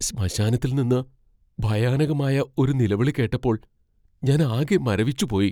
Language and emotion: Malayalam, fearful